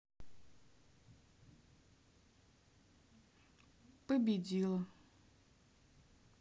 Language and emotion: Russian, sad